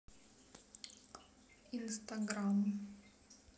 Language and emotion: Russian, neutral